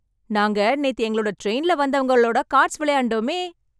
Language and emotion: Tamil, happy